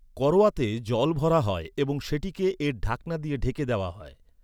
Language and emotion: Bengali, neutral